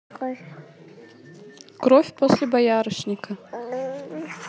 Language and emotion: Russian, neutral